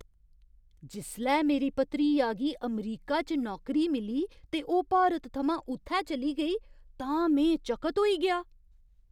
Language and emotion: Dogri, surprised